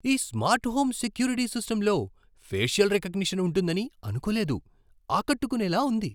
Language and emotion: Telugu, surprised